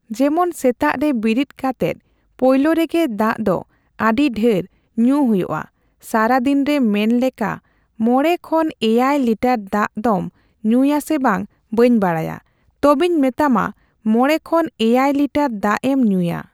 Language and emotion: Santali, neutral